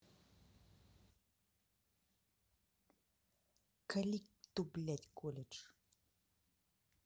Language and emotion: Russian, angry